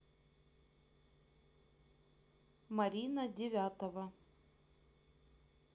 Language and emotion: Russian, neutral